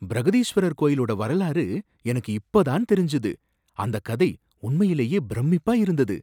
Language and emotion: Tamil, surprised